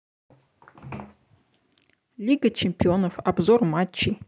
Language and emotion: Russian, neutral